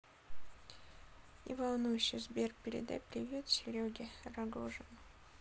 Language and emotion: Russian, sad